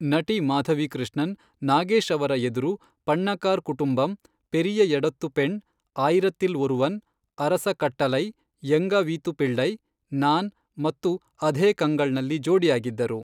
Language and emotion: Kannada, neutral